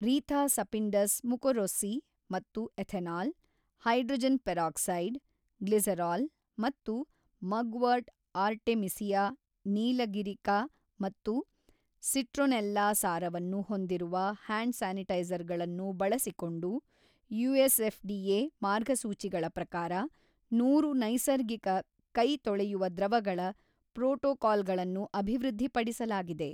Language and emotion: Kannada, neutral